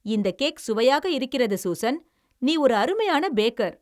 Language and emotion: Tamil, happy